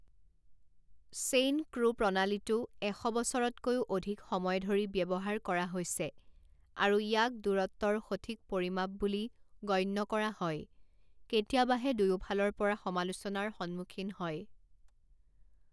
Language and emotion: Assamese, neutral